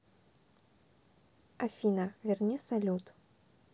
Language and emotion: Russian, neutral